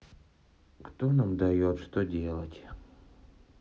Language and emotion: Russian, sad